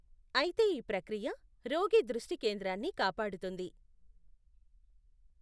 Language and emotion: Telugu, neutral